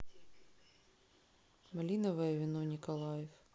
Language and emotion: Russian, neutral